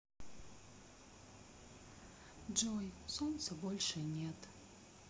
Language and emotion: Russian, sad